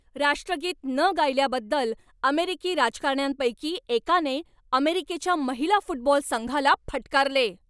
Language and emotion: Marathi, angry